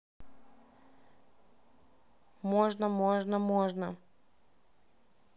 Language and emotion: Russian, neutral